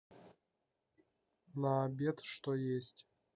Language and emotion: Russian, neutral